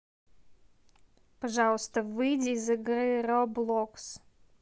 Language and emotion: Russian, neutral